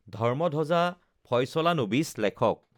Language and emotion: Assamese, neutral